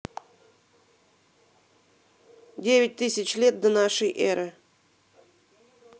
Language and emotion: Russian, neutral